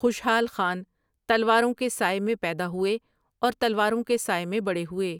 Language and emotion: Urdu, neutral